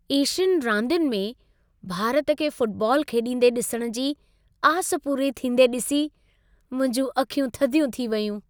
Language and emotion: Sindhi, happy